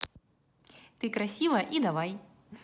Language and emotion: Russian, positive